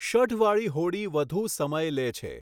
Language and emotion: Gujarati, neutral